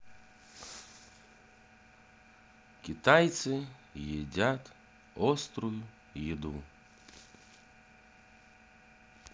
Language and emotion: Russian, neutral